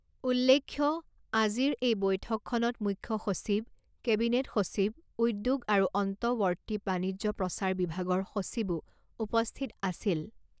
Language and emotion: Assamese, neutral